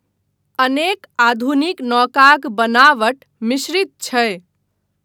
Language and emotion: Maithili, neutral